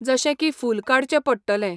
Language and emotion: Goan Konkani, neutral